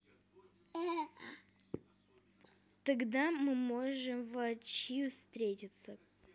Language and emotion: Russian, neutral